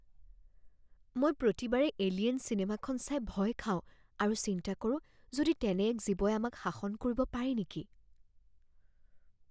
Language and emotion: Assamese, fearful